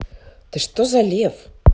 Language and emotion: Russian, positive